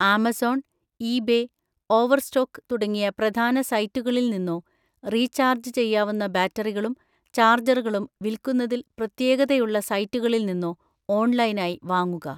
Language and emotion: Malayalam, neutral